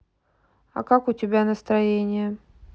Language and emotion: Russian, neutral